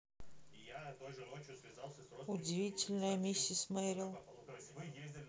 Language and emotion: Russian, neutral